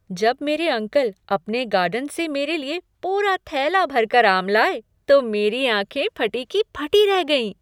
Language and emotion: Hindi, surprised